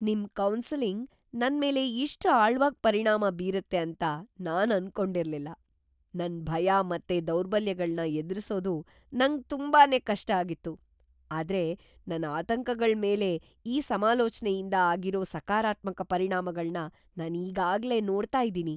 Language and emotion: Kannada, surprised